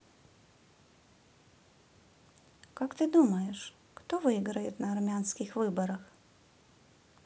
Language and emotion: Russian, neutral